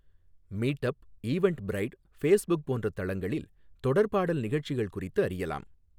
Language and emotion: Tamil, neutral